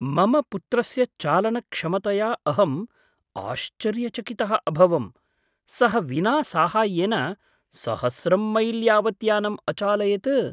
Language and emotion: Sanskrit, surprised